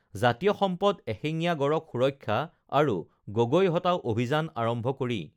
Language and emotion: Assamese, neutral